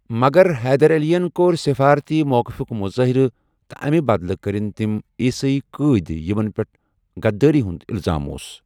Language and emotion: Kashmiri, neutral